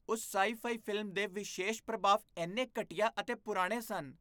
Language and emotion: Punjabi, disgusted